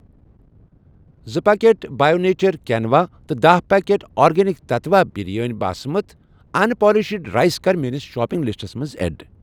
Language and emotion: Kashmiri, neutral